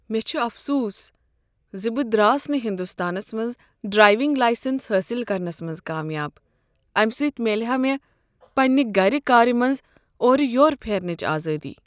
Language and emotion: Kashmiri, sad